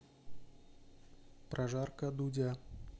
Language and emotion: Russian, neutral